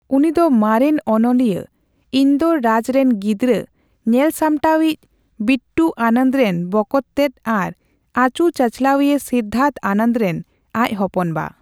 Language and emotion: Santali, neutral